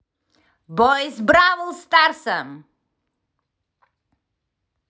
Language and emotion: Russian, angry